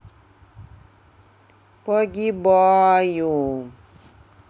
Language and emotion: Russian, sad